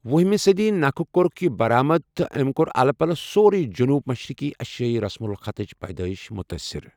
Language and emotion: Kashmiri, neutral